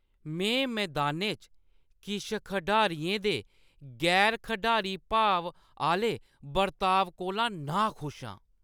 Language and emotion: Dogri, disgusted